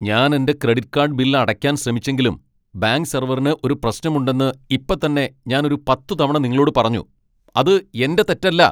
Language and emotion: Malayalam, angry